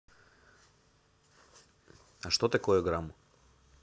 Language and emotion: Russian, neutral